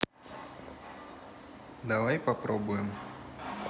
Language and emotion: Russian, neutral